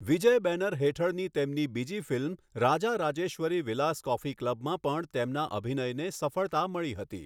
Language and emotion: Gujarati, neutral